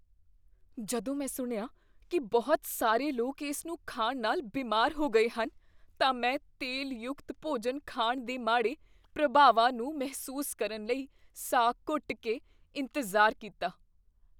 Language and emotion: Punjabi, fearful